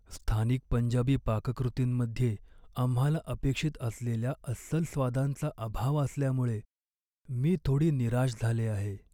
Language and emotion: Marathi, sad